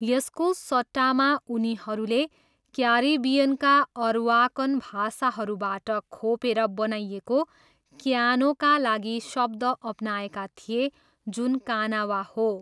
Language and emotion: Nepali, neutral